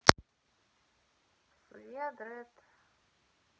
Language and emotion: Russian, neutral